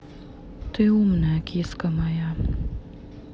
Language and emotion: Russian, sad